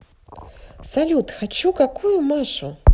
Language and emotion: Russian, positive